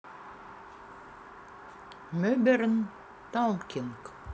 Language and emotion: Russian, neutral